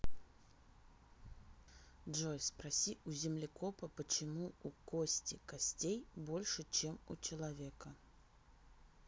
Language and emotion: Russian, neutral